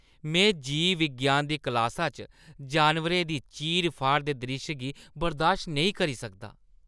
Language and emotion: Dogri, disgusted